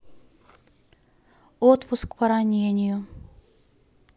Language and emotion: Russian, neutral